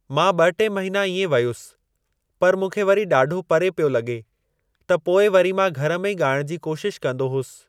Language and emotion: Sindhi, neutral